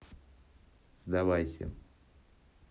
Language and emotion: Russian, neutral